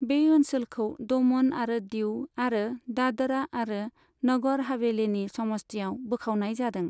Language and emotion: Bodo, neutral